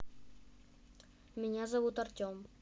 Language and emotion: Russian, neutral